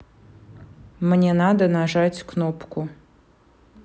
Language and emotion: Russian, neutral